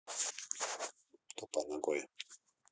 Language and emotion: Russian, neutral